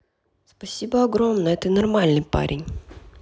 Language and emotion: Russian, neutral